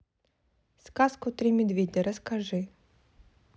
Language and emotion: Russian, neutral